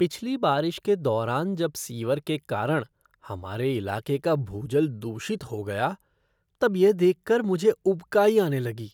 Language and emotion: Hindi, disgusted